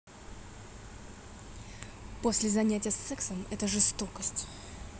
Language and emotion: Russian, angry